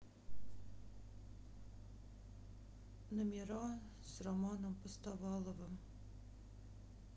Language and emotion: Russian, sad